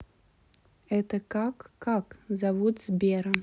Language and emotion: Russian, neutral